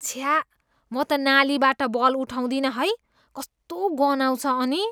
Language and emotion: Nepali, disgusted